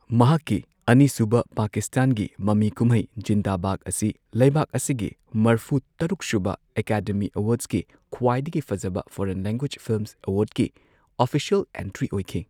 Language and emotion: Manipuri, neutral